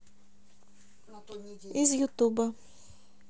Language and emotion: Russian, neutral